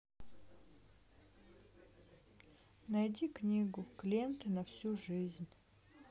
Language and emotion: Russian, sad